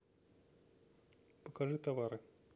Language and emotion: Russian, neutral